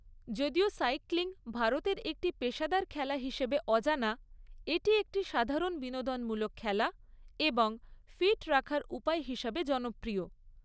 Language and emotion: Bengali, neutral